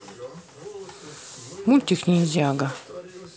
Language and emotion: Russian, neutral